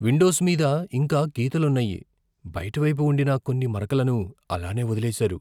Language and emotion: Telugu, fearful